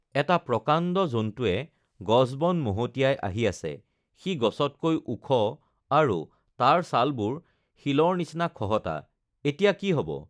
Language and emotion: Assamese, neutral